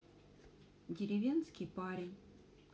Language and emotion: Russian, neutral